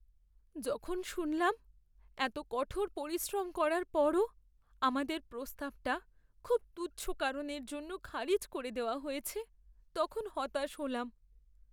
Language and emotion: Bengali, sad